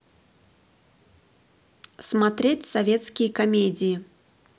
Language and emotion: Russian, positive